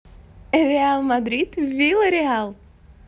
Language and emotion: Russian, positive